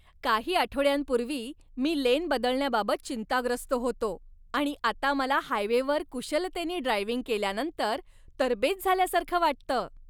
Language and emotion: Marathi, happy